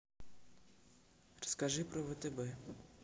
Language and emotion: Russian, neutral